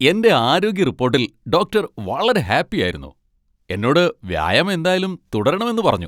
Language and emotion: Malayalam, happy